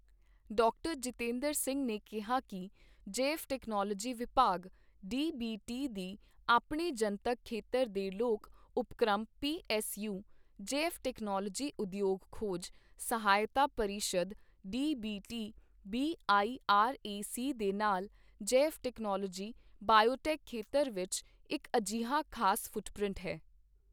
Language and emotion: Punjabi, neutral